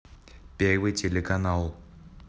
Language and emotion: Russian, neutral